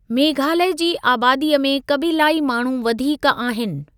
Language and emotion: Sindhi, neutral